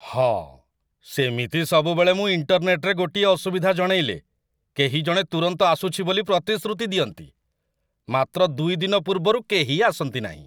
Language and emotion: Odia, disgusted